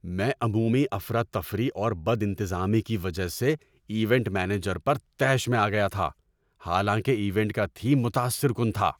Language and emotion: Urdu, angry